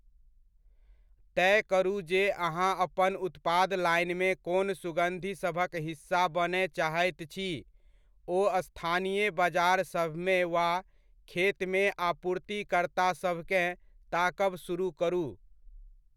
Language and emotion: Maithili, neutral